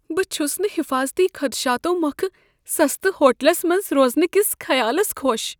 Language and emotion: Kashmiri, fearful